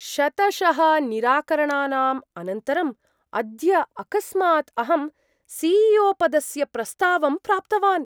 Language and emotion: Sanskrit, surprised